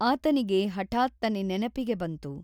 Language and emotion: Kannada, neutral